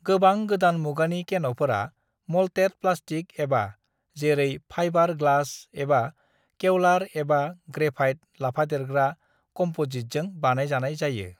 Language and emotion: Bodo, neutral